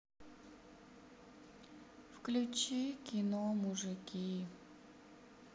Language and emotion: Russian, sad